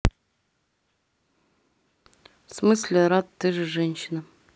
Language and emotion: Russian, neutral